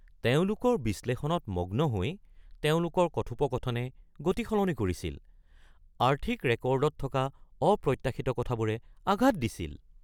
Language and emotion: Assamese, surprised